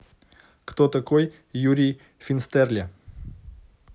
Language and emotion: Russian, neutral